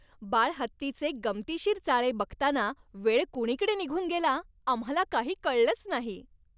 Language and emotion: Marathi, happy